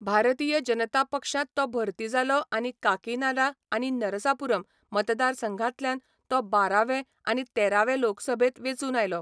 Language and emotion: Goan Konkani, neutral